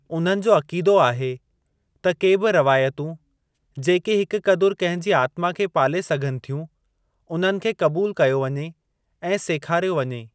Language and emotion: Sindhi, neutral